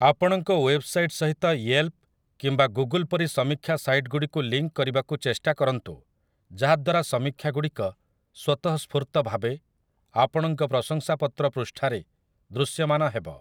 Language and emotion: Odia, neutral